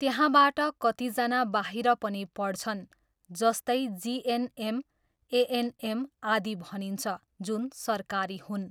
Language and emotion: Nepali, neutral